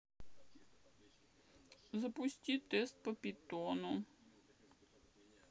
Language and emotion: Russian, sad